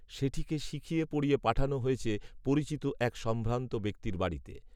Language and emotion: Bengali, neutral